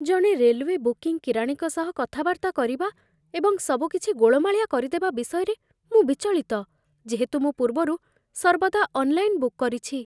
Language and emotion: Odia, fearful